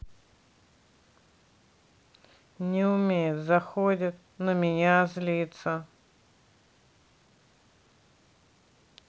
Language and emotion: Russian, neutral